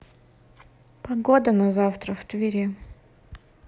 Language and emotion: Russian, neutral